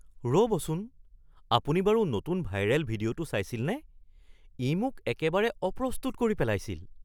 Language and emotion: Assamese, surprised